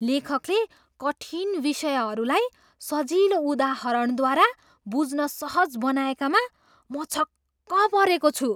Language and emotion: Nepali, surprised